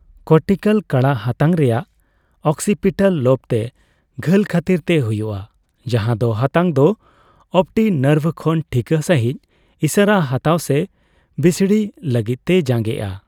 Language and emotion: Santali, neutral